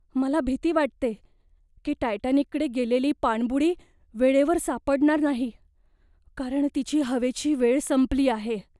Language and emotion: Marathi, fearful